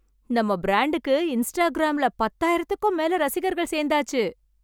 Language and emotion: Tamil, happy